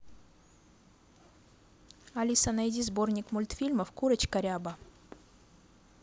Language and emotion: Russian, neutral